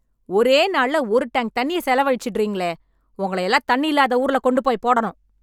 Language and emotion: Tamil, angry